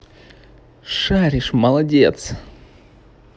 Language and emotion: Russian, positive